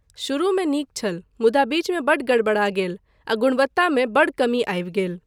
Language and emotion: Maithili, neutral